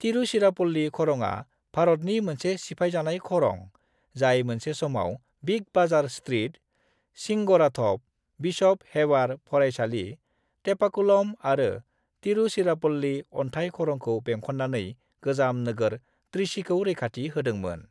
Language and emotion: Bodo, neutral